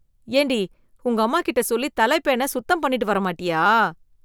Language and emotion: Tamil, disgusted